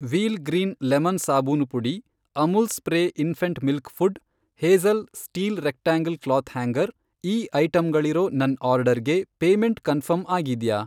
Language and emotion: Kannada, neutral